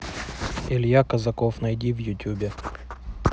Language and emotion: Russian, neutral